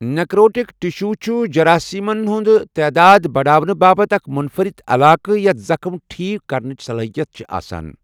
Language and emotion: Kashmiri, neutral